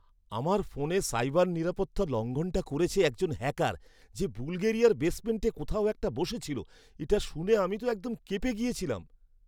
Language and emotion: Bengali, surprised